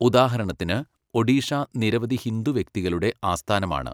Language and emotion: Malayalam, neutral